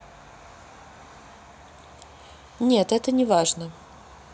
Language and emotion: Russian, neutral